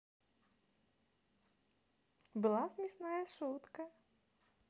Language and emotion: Russian, positive